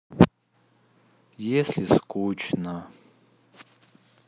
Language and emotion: Russian, sad